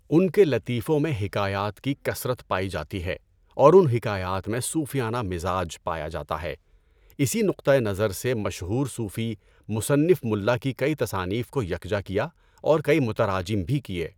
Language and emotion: Urdu, neutral